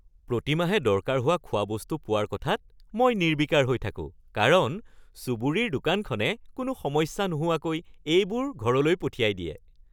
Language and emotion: Assamese, happy